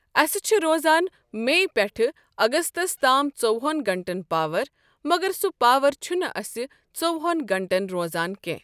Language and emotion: Kashmiri, neutral